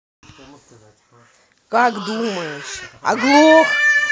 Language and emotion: Russian, angry